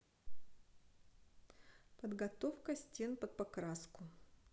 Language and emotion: Russian, neutral